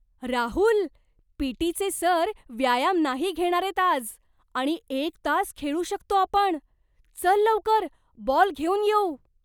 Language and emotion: Marathi, surprised